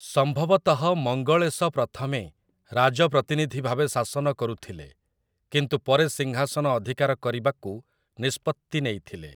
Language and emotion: Odia, neutral